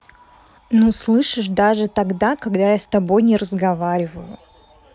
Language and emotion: Russian, neutral